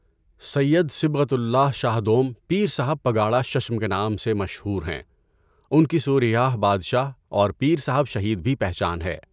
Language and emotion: Urdu, neutral